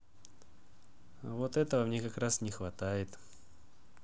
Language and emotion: Russian, neutral